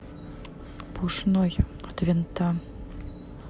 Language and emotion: Russian, neutral